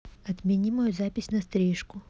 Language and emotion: Russian, neutral